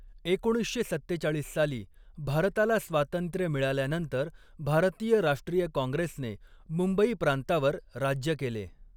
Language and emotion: Marathi, neutral